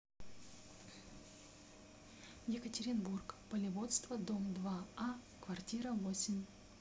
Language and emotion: Russian, neutral